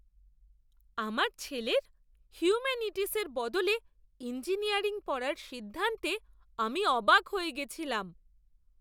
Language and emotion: Bengali, surprised